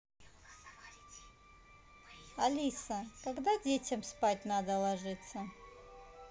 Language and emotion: Russian, neutral